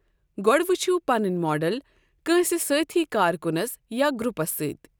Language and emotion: Kashmiri, neutral